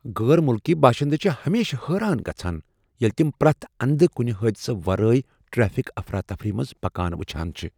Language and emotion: Kashmiri, surprised